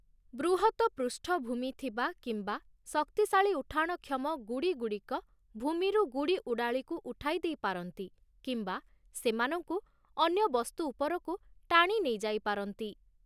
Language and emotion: Odia, neutral